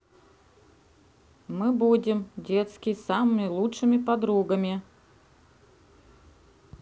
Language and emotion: Russian, neutral